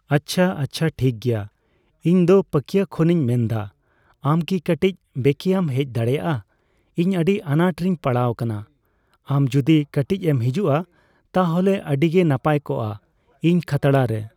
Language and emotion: Santali, neutral